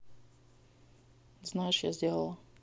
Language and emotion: Russian, neutral